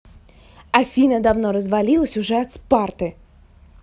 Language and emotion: Russian, angry